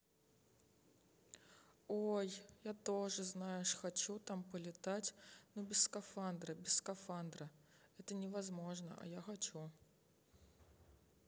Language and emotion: Russian, sad